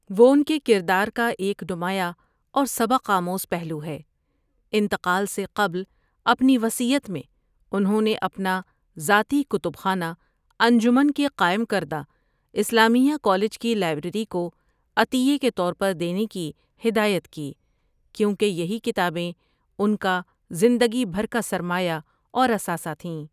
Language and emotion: Urdu, neutral